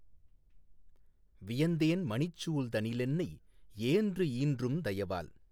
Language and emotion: Tamil, neutral